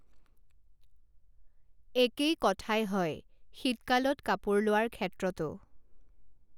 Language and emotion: Assamese, neutral